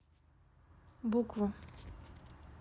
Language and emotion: Russian, neutral